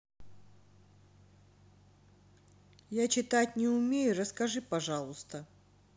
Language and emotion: Russian, neutral